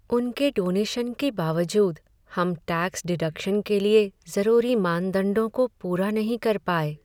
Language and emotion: Hindi, sad